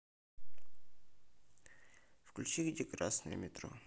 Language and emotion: Russian, neutral